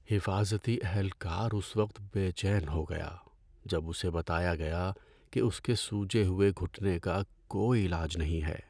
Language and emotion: Urdu, sad